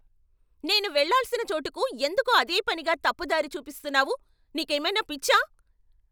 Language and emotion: Telugu, angry